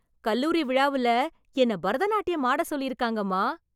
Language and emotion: Tamil, happy